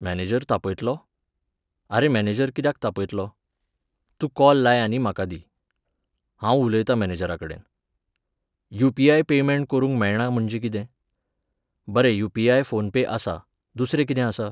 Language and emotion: Goan Konkani, neutral